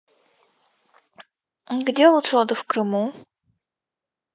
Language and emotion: Russian, neutral